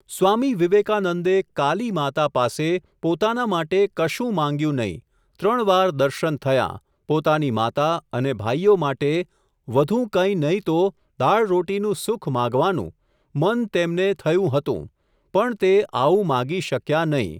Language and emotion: Gujarati, neutral